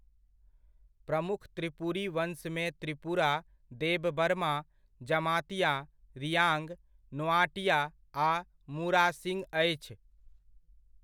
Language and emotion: Maithili, neutral